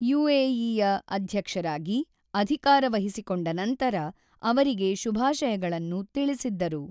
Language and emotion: Kannada, neutral